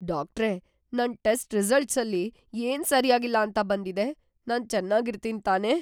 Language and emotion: Kannada, fearful